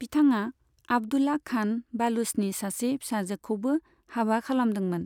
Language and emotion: Bodo, neutral